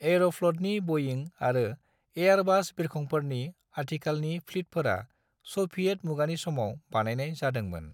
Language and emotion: Bodo, neutral